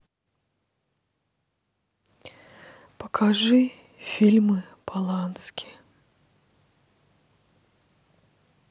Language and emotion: Russian, sad